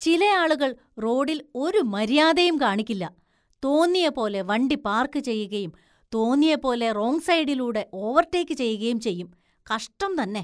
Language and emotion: Malayalam, disgusted